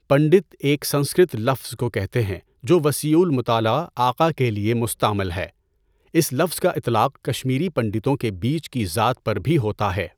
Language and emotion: Urdu, neutral